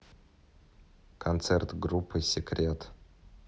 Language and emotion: Russian, neutral